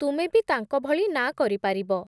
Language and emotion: Odia, neutral